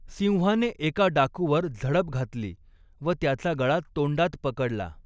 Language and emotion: Marathi, neutral